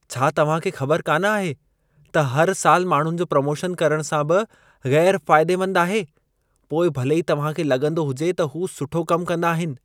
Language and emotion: Sindhi, disgusted